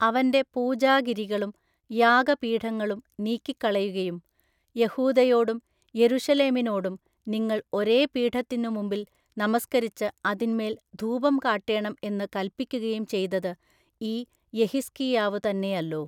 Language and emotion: Malayalam, neutral